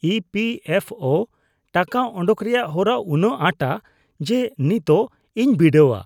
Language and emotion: Santali, disgusted